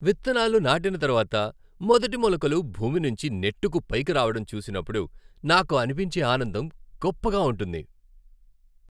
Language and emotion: Telugu, happy